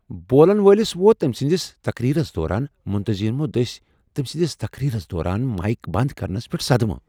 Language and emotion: Kashmiri, surprised